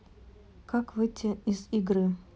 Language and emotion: Russian, neutral